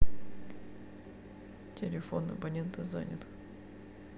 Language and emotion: Russian, sad